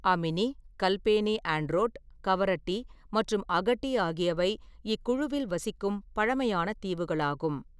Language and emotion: Tamil, neutral